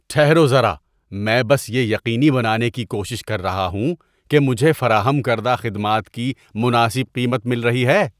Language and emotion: Urdu, disgusted